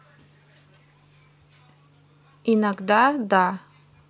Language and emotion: Russian, neutral